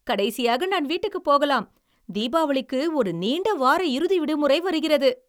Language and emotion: Tamil, happy